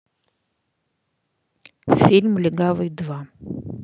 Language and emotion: Russian, neutral